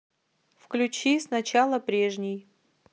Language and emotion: Russian, neutral